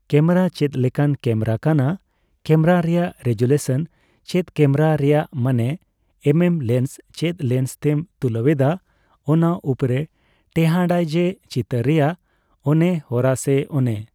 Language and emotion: Santali, neutral